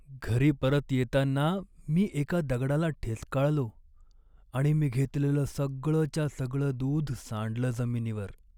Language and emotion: Marathi, sad